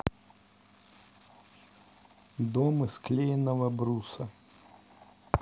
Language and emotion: Russian, neutral